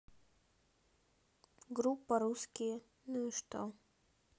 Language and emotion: Russian, neutral